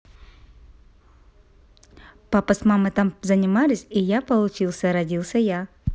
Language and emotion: Russian, positive